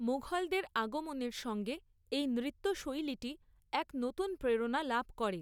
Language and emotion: Bengali, neutral